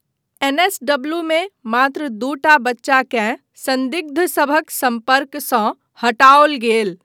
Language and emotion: Maithili, neutral